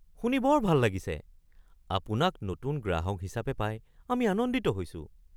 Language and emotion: Assamese, surprised